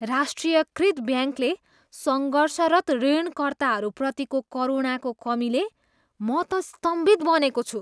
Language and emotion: Nepali, disgusted